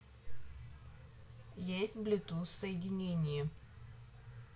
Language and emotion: Russian, neutral